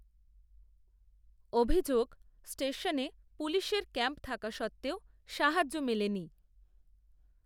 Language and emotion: Bengali, neutral